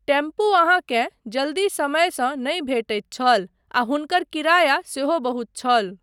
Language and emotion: Maithili, neutral